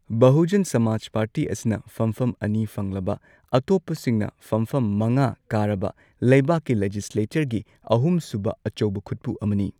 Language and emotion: Manipuri, neutral